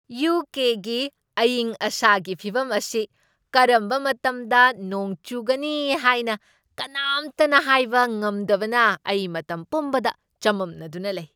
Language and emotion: Manipuri, surprised